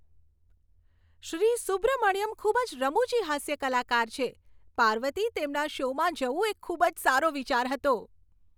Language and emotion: Gujarati, happy